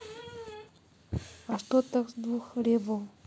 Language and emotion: Russian, neutral